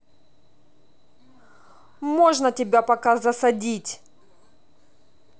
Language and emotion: Russian, angry